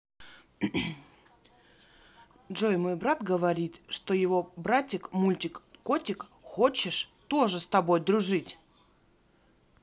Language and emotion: Russian, neutral